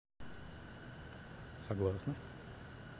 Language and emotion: Russian, neutral